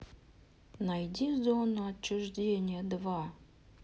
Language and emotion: Russian, neutral